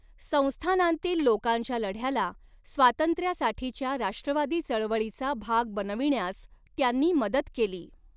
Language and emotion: Marathi, neutral